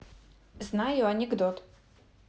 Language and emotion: Russian, neutral